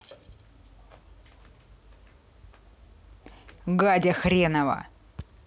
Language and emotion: Russian, angry